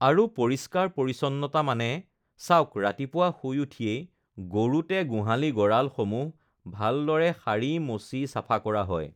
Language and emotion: Assamese, neutral